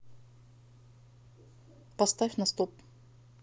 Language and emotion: Russian, neutral